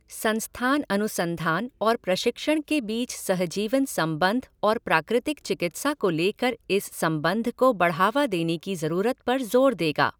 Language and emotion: Hindi, neutral